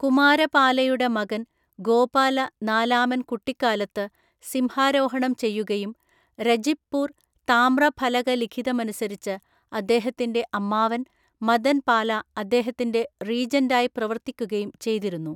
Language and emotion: Malayalam, neutral